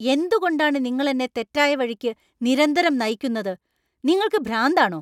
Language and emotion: Malayalam, angry